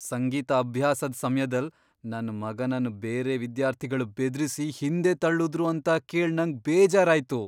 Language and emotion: Kannada, surprised